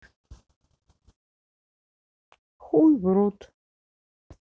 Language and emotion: Russian, neutral